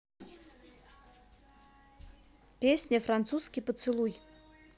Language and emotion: Russian, neutral